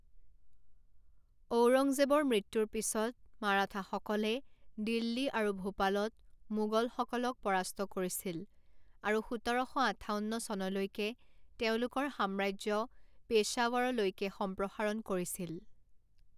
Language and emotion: Assamese, neutral